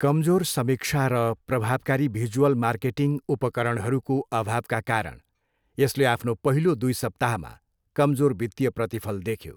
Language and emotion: Nepali, neutral